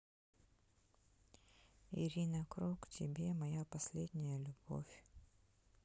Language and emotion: Russian, sad